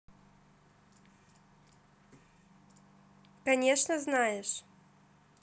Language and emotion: Russian, positive